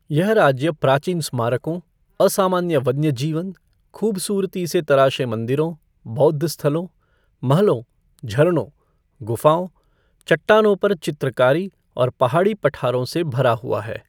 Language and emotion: Hindi, neutral